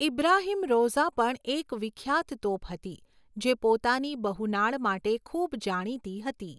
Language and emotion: Gujarati, neutral